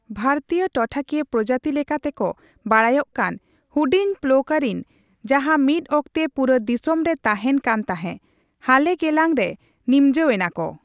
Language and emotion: Santali, neutral